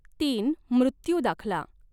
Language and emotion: Marathi, neutral